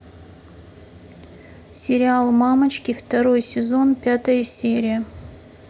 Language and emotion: Russian, neutral